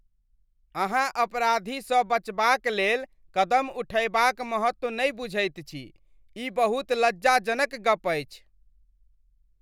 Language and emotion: Maithili, disgusted